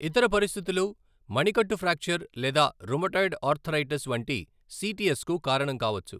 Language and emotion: Telugu, neutral